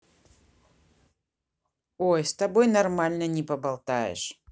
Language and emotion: Russian, neutral